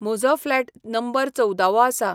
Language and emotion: Goan Konkani, neutral